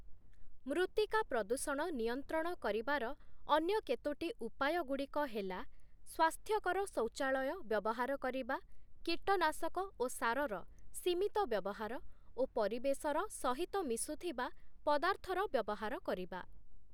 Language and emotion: Odia, neutral